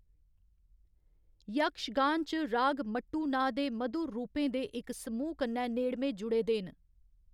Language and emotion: Dogri, neutral